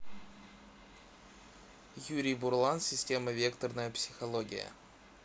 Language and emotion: Russian, neutral